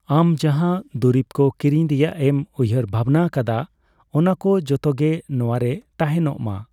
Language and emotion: Santali, neutral